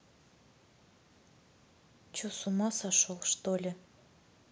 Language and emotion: Russian, neutral